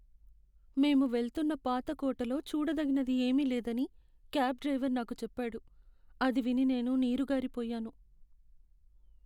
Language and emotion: Telugu, sad